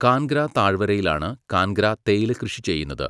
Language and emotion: Malayalam, neutral